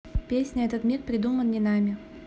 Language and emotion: Russian, neutral